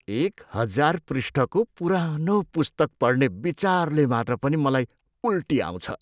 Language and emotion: Nepali, disgusted